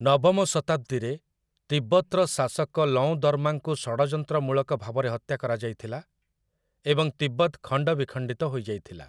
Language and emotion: Odia, neutral